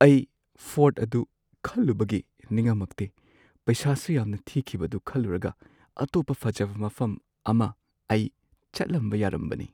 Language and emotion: Manipuri, sad